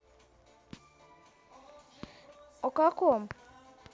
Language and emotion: Russian, neutral